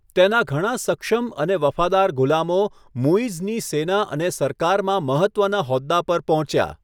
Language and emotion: Gujarati, neutral